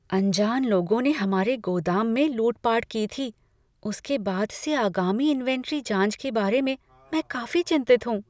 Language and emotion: Hindi, fearful